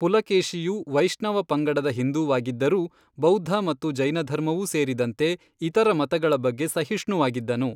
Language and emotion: Kannada, neutral